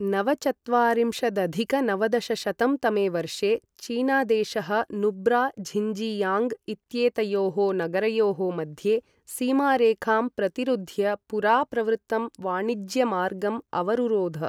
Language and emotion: Sanskrit, neutral